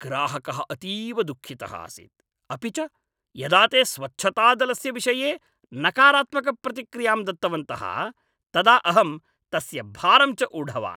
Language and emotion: Sanskrit, angry